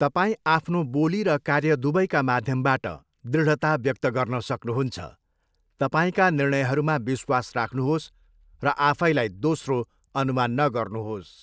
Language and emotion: Nepali, neutral